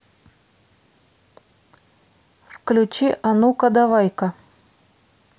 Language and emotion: Russian, neutral